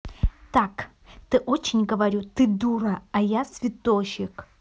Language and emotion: Russian, angry